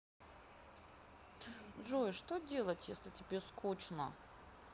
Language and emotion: Russian, sad